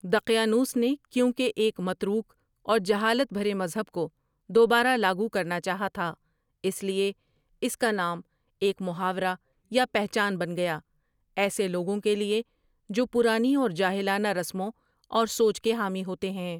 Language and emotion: Urdu, neutral